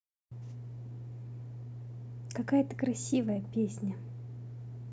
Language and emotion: Russian, positive